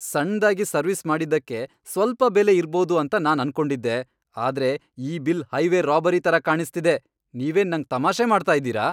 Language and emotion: Kannada, angry